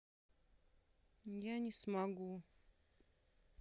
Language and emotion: Russian, sad